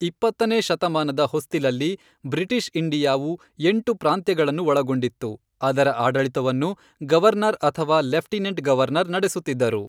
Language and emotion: Kannada, neutral